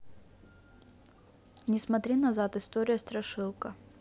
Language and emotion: Russian, neutral